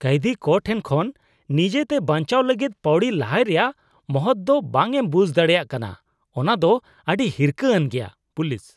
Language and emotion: Santali, disgusted